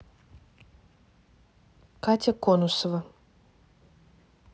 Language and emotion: Russian, neutral